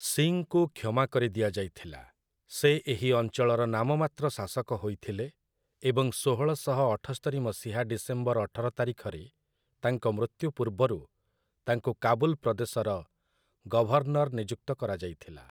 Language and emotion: Odia, neutral